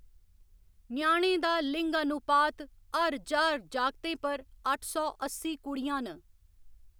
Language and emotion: Dogri, neutral